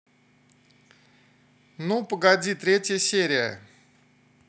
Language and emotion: Russian, neutral